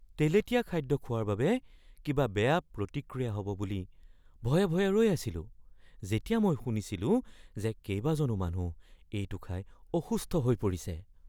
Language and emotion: Assamese, fearful